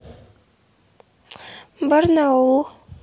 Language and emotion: Russian, neutral